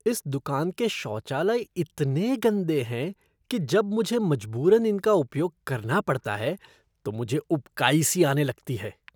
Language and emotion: Hindi, disgusted